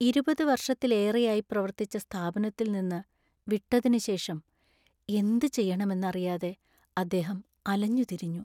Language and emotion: Malayalam, sad